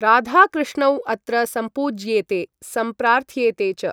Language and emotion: Sanskrit, neutral